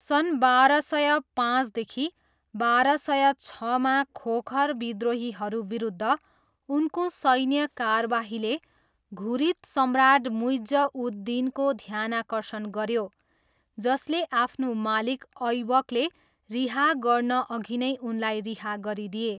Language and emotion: Nepali, neutral